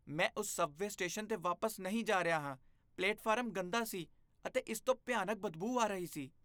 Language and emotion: Punjabi, disgusted